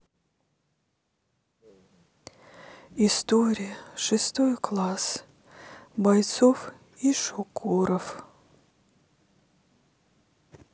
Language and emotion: Russian, sad